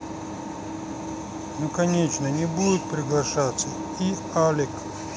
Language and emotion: Russian, neutral